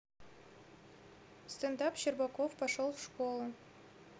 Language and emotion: Russian, neutral